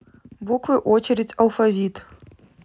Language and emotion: Russian, neutral